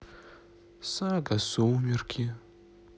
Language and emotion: Russian, sad